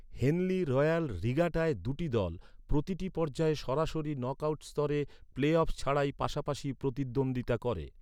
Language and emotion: Bengali, neutral